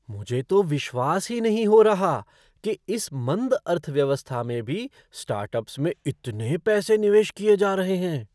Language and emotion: Hindi, surprised